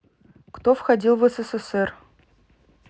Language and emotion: Russian, neutral